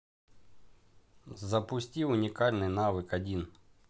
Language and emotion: Russian, neutral